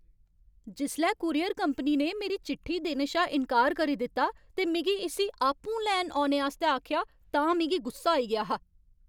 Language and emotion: Dogri, angry